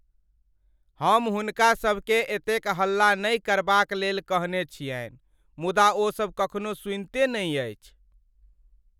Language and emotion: Maithili, sad